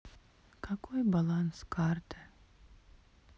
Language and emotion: Russian, sad